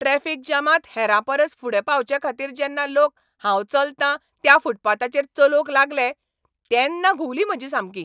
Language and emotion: Goan Konkani, angry